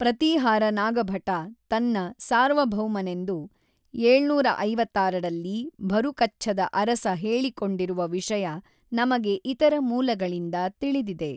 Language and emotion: Kannada, neutral